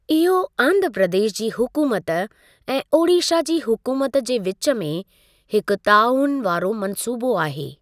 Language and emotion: Sindhi, neutral